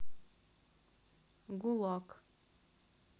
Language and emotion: Russian, neutral